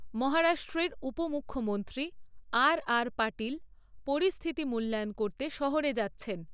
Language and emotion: Bengali, neutral